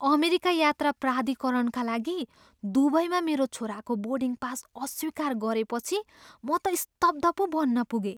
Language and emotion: Nepali, surprised